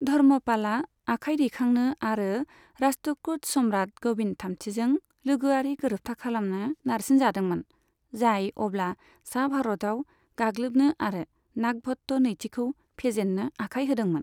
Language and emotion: Bodo, neutral